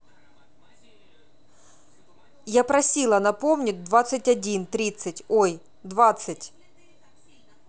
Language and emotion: Russian, angry